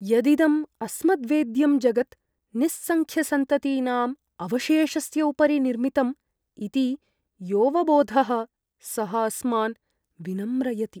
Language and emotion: Sanskrit, fearful